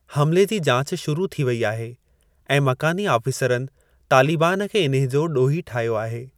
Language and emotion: Sindhi, neutral